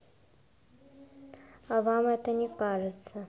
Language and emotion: Russian, neutral